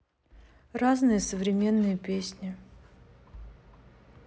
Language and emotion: Russian, neutral